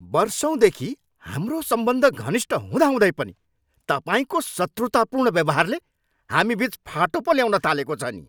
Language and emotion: Nepali, angry